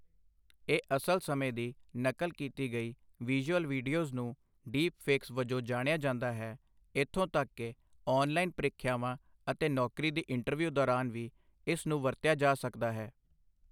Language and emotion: Punjabi, neutral